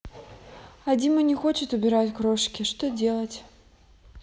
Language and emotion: Russian, neutral